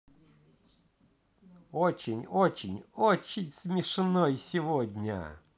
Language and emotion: Russian, positive